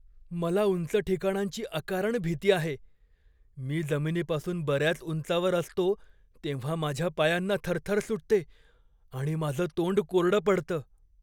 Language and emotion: Marathi, fearful